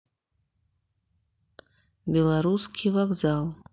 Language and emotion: Russian, neutral